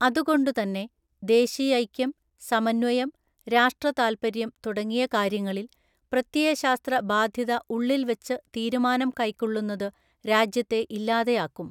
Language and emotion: Malayalam, neutral